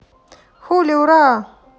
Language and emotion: Russian, positive